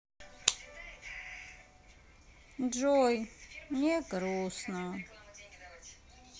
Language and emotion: Russian, sad